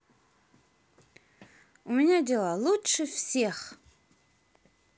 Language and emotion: Russian, positive